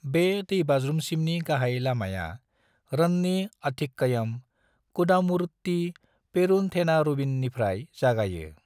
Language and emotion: Bodo, neutral